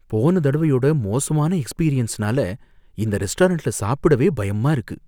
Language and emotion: Tamil, fearful